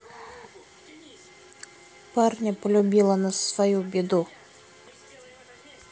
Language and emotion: Russian, neutral